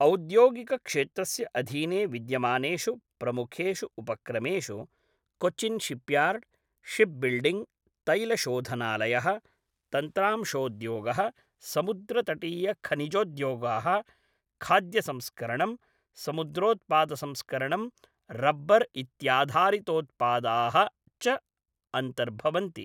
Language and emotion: Sanskrit, neutral